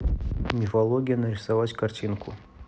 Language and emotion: Russian, neutral